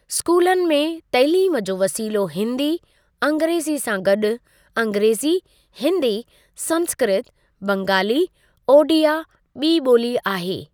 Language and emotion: Sindhi, neutral